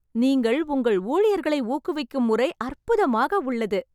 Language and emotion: Tamil, happy